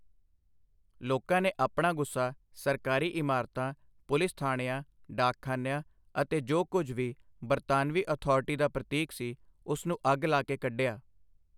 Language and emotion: Punjabi, neutral